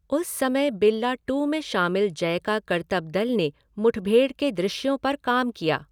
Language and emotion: Hindi, neutral